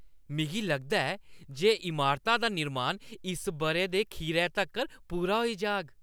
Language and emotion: Dogri, happy